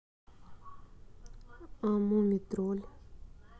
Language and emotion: Russian, neutral